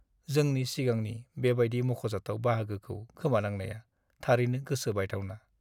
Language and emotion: Bodo, sad